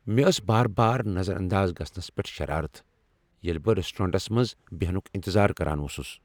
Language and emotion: Kashmiri, angry